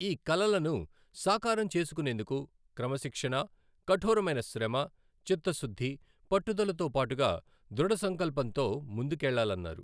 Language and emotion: Telugu, neutral